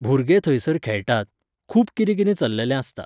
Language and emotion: Goan Konkani, neutral